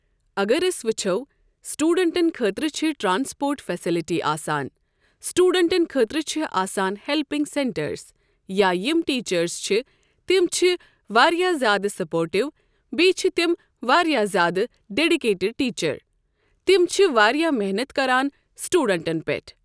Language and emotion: Kashmiri, neutral